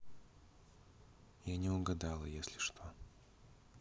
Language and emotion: Russian, neutral